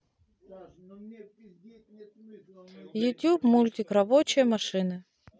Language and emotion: Russian, neutral